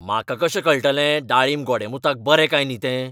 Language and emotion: Goan Konkani, angry